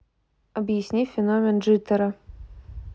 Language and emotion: Russian, neutral